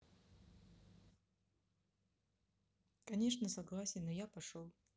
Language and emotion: Russian, neutral